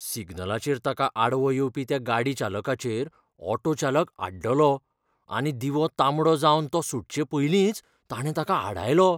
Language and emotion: Goan Konkani, fearful